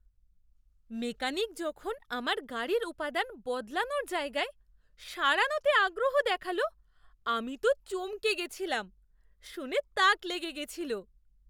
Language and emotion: Bengali, surprised